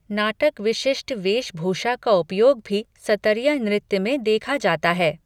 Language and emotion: Hindi, neutral